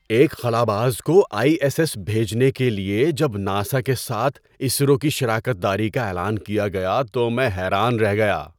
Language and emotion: Urdu, surprised